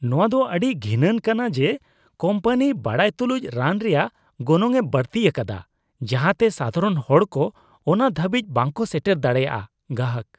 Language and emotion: Santali, disgusted